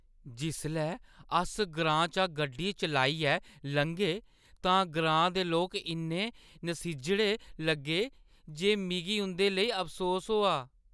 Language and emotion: Dogri, sad